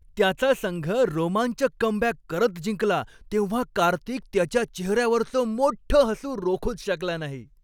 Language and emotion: Marathi, happy